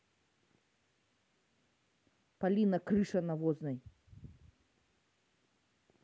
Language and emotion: Russian, angry